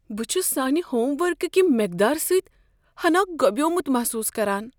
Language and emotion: Kashmiri, fearful